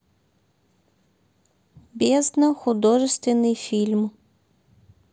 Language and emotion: Russian, neutral